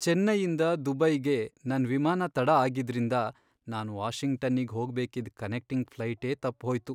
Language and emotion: Kannada, sad